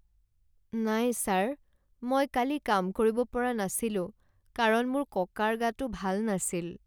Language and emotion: Assamese, sad